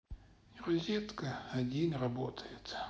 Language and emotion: Russian, sad